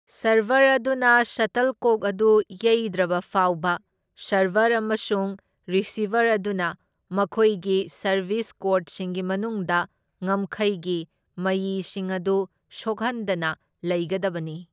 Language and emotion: Manipuri, neutral